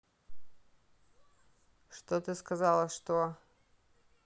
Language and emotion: Russian, neutral